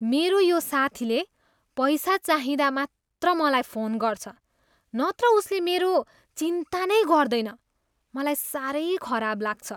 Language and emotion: Nepali, disgusted